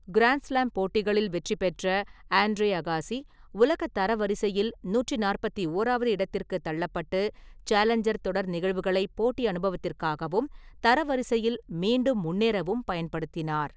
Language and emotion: Tamil, neutral